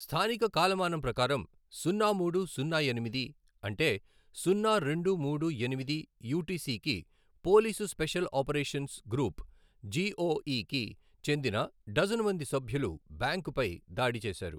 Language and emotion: Telugu, neutral